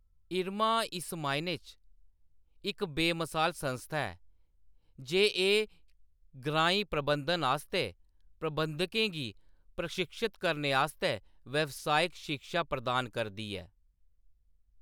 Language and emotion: Dogri, neutral